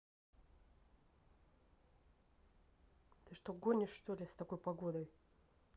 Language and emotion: Russian, angry